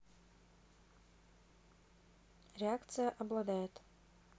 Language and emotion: Russian, neutral